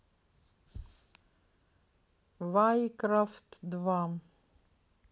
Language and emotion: Russian, neutral